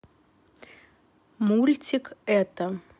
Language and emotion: Russian, neutral